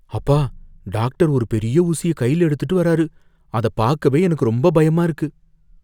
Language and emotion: Tamil, fearful